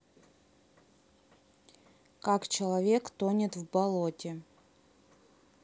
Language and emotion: Russian, neutral